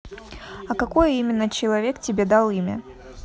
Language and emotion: Russian, neutral